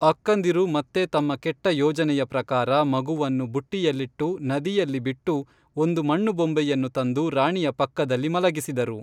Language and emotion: Kannada, neutral